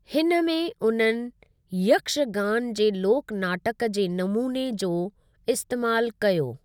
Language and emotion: Sindhi, neutral